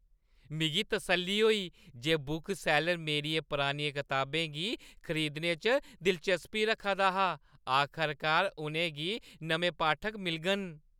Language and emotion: Dogri, happy